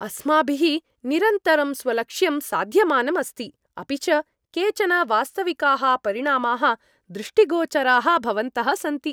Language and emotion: Sanskrit, happy